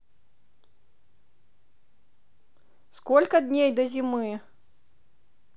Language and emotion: Russian, positive